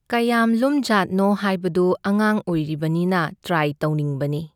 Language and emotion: Manipuri, neutral